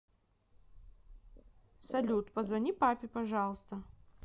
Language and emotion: Russian, neutral